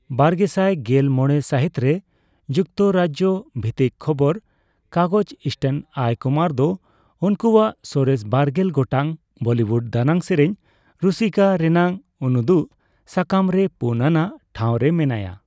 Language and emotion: Santali, neutral